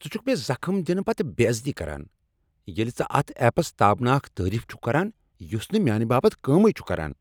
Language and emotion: Kashmiri, angry